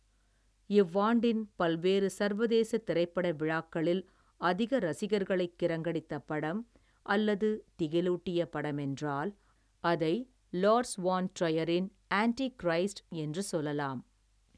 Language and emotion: Tamil, neutral